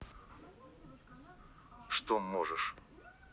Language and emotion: Russian, angry